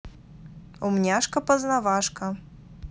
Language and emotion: Russian, positive